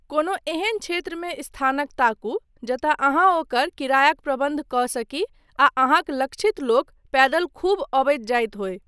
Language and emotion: Maithili, neutral